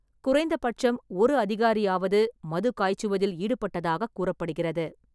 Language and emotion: Tamil, neutral